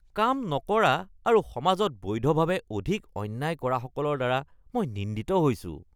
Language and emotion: Assamese, disgusted